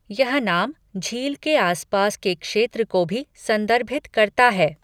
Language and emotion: Hindi, neutral